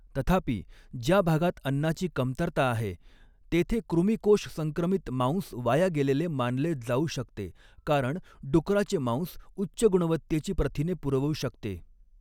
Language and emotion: Marathi, neutral